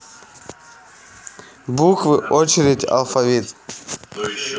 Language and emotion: Russian, neutral